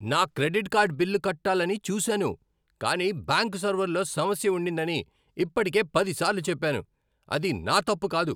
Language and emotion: Telugu, angry